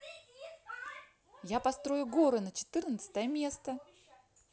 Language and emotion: Russian, positive